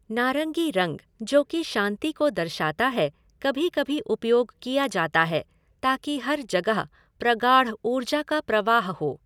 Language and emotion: Hindi, neutral